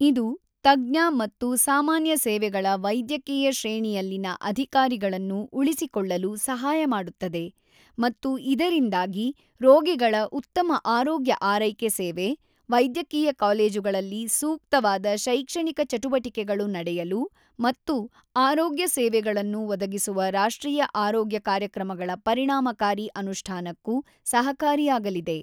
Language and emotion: Kannada, neutral